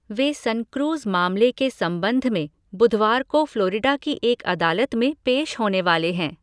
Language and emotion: Hindi, neutral